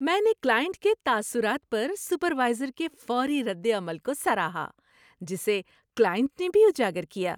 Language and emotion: Urdu, happy